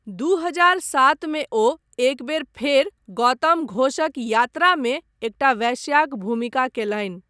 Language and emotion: Maithili, neutral